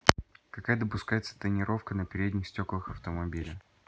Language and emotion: Russian, neutral